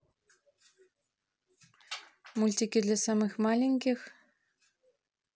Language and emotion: Russian, neutral